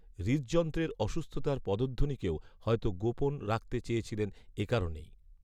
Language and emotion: Bengali, neutral